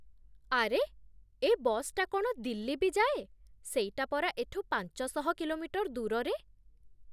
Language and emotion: Odia, surprised